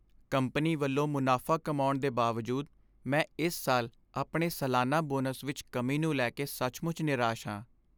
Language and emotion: Punjabi, sad